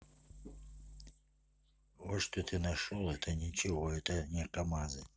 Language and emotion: Russian, neutral